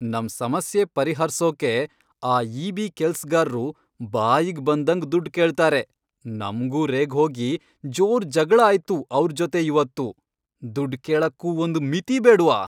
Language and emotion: Kannada, angry